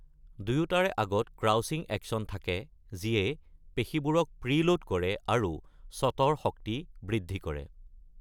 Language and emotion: Assamese, neutral